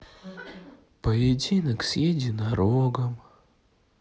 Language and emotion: Russian, sad